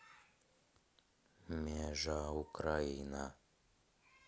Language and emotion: Russian, neutral